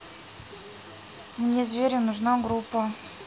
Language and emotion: Russian, neutral